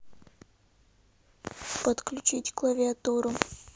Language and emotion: Russian, neutral